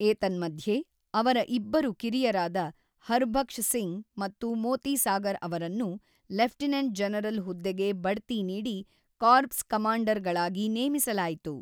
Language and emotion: Kannada, neutral